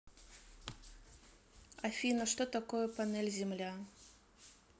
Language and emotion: Russian, neutral